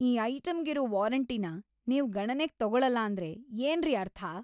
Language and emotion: Kannada, angry